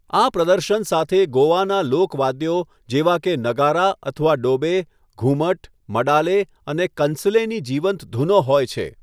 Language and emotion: Gujarati, neutral